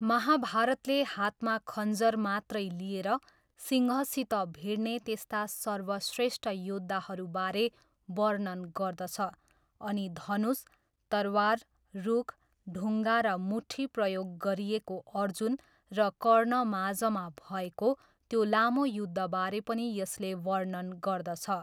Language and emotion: Nepali, neutral